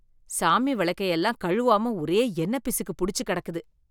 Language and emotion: Tamil, disgusted